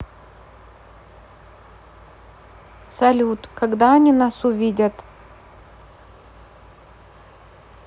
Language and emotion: Russian, neutral